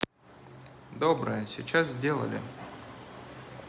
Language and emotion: Russian, neutral